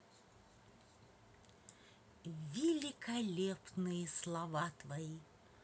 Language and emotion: Russian, positive